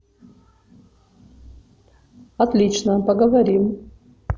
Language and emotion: Russian, neutral